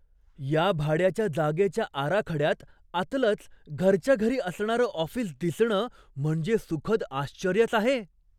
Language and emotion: Marathi, surprised